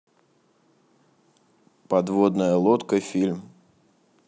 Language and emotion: Russian, neutral